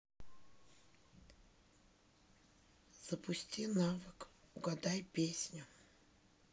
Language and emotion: Russian, sad